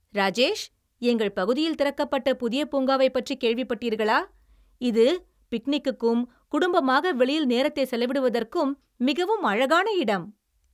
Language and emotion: Tamil, happy